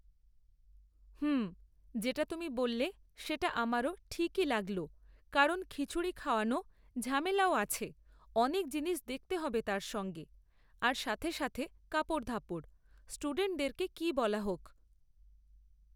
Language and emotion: Bengali, neutral